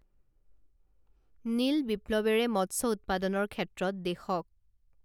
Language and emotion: Assamese, neutral